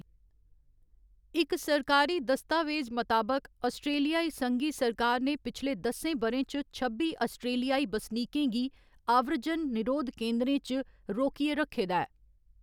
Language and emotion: Dogri, neutral